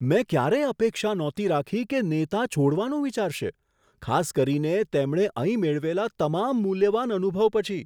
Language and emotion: Gujarati, surprised